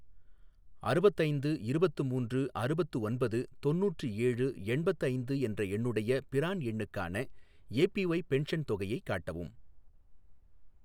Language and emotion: Tamil, neutral